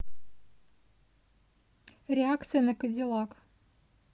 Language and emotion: Russian, neutral